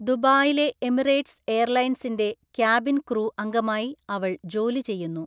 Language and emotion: Malayalam, neutral